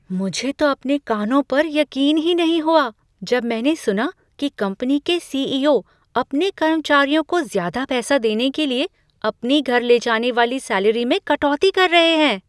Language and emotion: Hindi, surprised